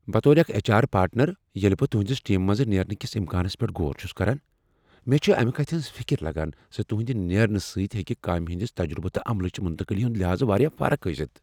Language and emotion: Kashmiri, fearful